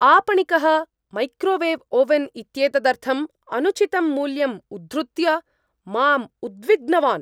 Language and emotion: Sanskrit, angry